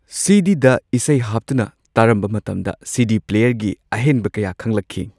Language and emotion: Manipuri, neutral